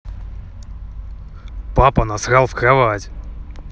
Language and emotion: Russian, angry